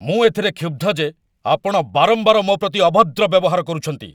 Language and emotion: Odia, angry